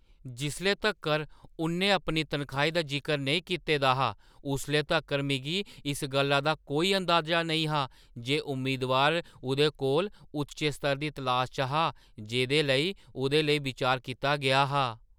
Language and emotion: Dogri, surprised